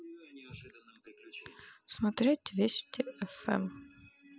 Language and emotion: Russian, neutral